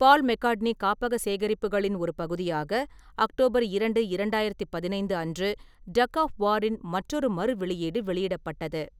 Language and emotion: Tamil, neutral